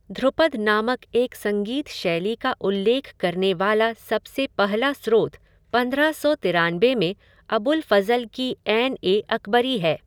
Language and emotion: Hindi, neutral